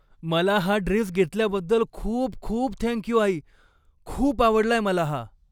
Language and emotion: Marathi, happy